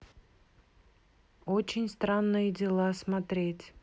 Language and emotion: Russian, neutral